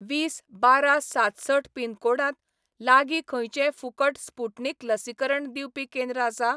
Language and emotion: Goan Konkani, neutral